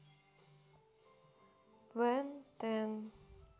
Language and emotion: Russian, neutral